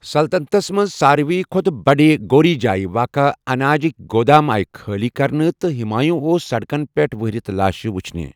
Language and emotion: Kashmiri, neutral